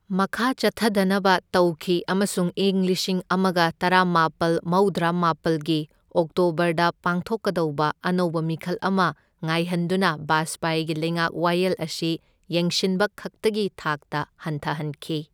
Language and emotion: Manipuri, neutral